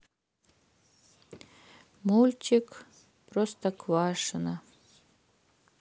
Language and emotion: Russian, sad